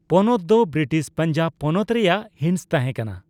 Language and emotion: Santali, neutral